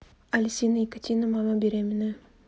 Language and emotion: Russian, neutral